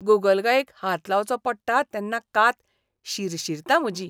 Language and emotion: Goan Konkani, disgusted